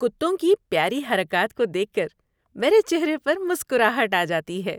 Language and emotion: Urdu, happy